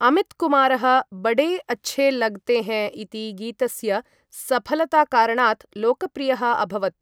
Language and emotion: Sanskrit, neutral